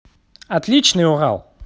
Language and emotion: Russian, positive